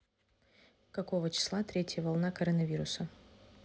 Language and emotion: Russian, neutral